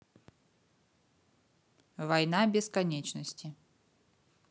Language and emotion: Russian, neutral